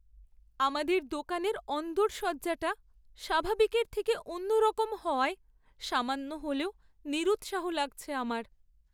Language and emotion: Bengali, sad